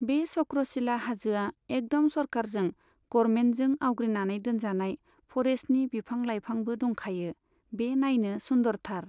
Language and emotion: Bodo, neutral